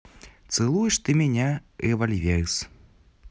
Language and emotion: Russian, positive